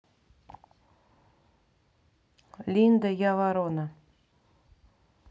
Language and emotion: Russian, neutral